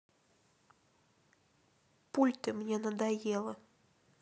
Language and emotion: Russian, sad